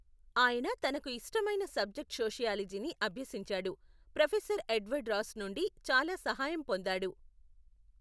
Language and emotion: Telugu, neutral